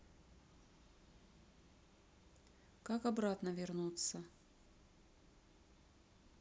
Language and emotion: Russian, neutral